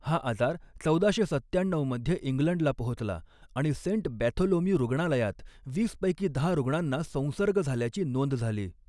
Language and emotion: Marathi, neutral